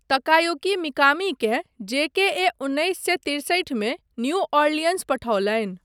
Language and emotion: Maithili, neutral